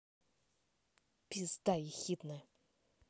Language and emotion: Russian, angry